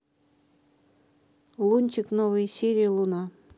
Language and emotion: Russian, neutral